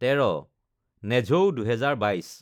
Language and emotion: Assamese, neutral